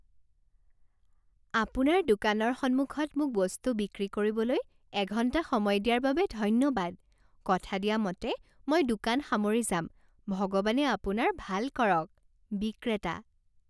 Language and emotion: Assamese, happy